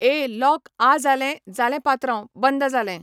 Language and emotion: Goan Konkani, neutral